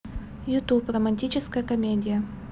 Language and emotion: Russian, neutral